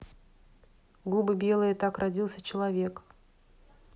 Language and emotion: Russian, neutral